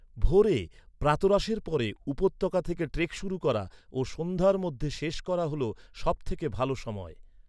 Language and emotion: Bengali, neutral